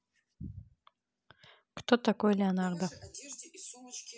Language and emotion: Russian, neutral